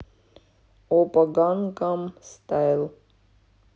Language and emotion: Russian, neutral